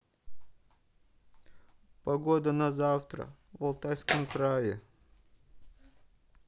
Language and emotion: Russian, sad